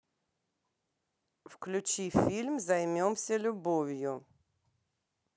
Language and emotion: Russian, neutral